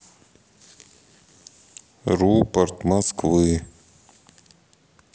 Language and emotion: Russian, neutral